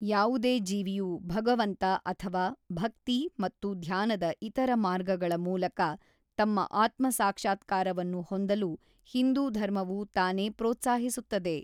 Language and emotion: Kannada, neutral